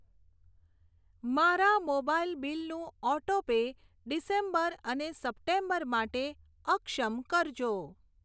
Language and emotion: Gujarati, neutral